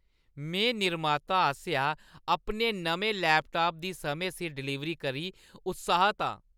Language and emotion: Dogri, happy